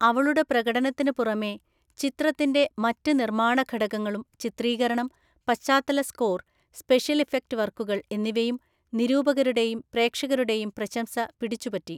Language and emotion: Malayalam, neutral